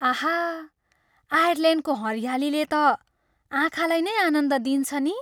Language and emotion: Nepali, happy